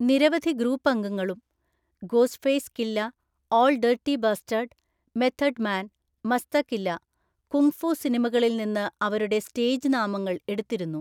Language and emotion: Malayalam, neutral